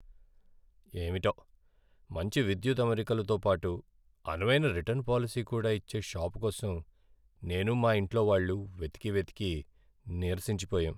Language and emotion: Telugu, sad